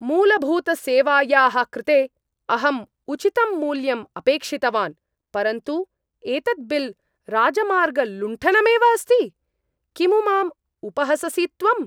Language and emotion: Sanskrit, angry